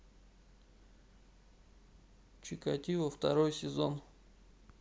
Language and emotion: Russian, neutral